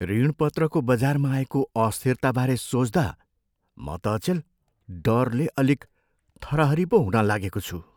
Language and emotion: Nepali, fearful